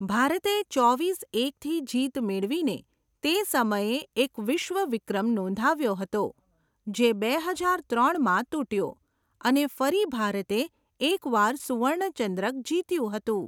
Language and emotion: Gujarati, neutral